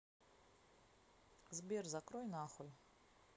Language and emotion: Russian, neutral